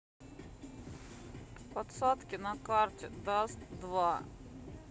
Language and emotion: Russian, sad